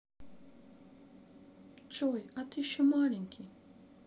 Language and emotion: Russian, neutral